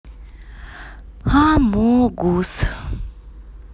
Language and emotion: Russian, neutral